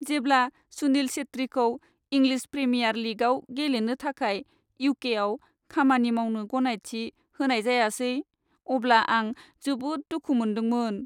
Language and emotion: Bodo, sad